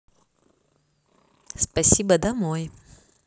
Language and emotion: Russian, positive